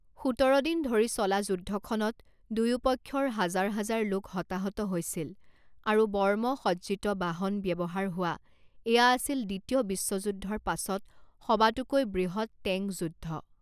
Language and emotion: Assamese, neutral